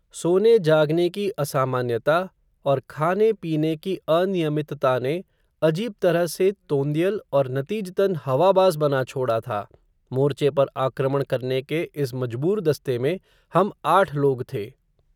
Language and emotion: Hindi, neutral